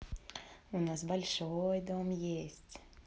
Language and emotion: Russian, positive